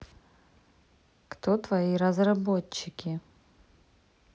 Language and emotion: Russian, neutral